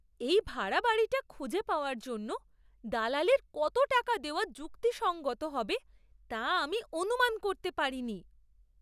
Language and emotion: Bengali, surprised